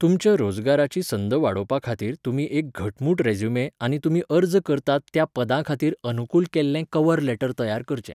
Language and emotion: Goan Konkani, neutral